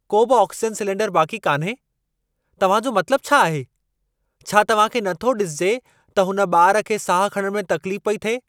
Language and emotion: Sindhi, angry